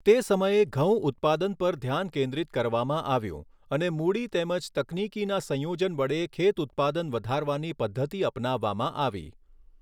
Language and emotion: Gujarati, neutral